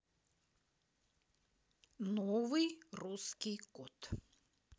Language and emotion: Russian, neutral